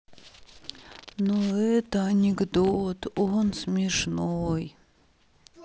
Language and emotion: Russian, sad